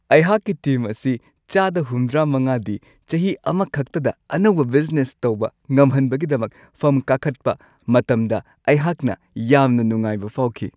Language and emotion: Manipuri, happy